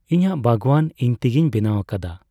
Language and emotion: Santali, neutral